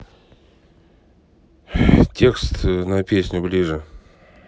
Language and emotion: Russian, neutral